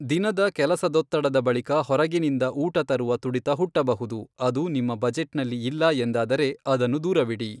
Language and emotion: Kannada, neutral